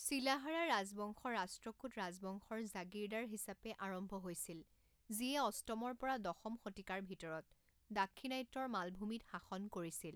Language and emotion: Assamese, neutral